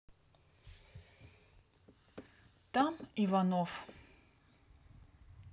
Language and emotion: Russian, neutral